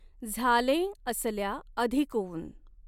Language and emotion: Marathi, neutral